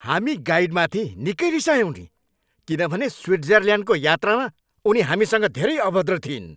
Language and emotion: Nepali, angry